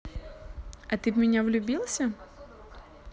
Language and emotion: Russian, positive